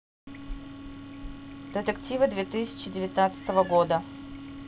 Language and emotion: Russian, neutral